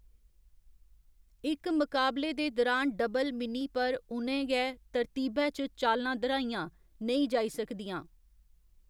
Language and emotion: Dogri, neutral